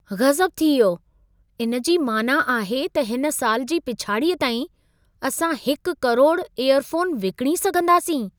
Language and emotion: Sindhi, surprised